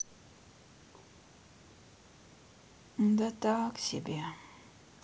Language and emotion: Russian, sad